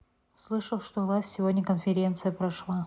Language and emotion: Russian, neutral